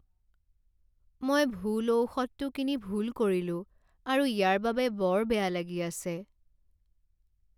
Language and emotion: Assamese, sad